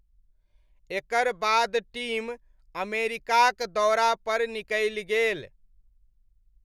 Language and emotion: Maithili, neutral